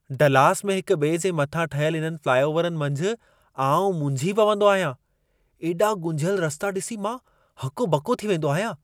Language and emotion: Sindhi, surprised